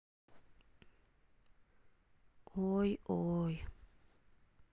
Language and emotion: Russian, sad